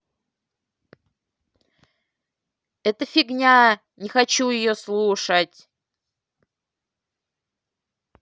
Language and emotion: Russian, angry